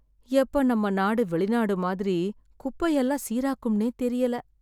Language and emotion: Tamil, sad